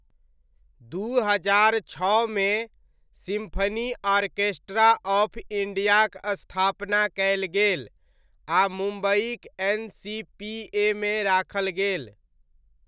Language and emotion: Maithili, neutral